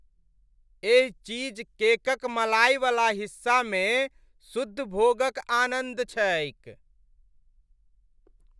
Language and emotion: Maithili, happy